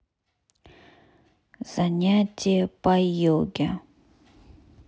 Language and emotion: Russian, neutral